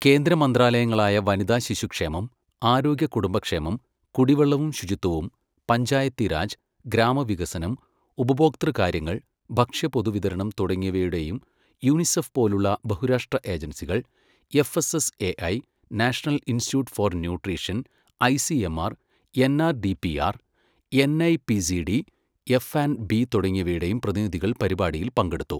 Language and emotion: Malayalam, neutral